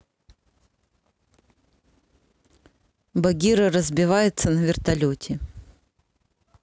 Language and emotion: Russian, neutral